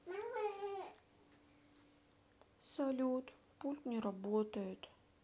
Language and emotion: Russian, sad